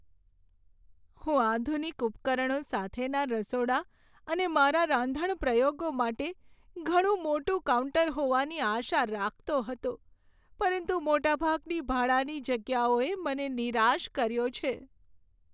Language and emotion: Gujarati, sad